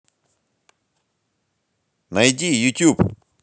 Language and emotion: Russian, positive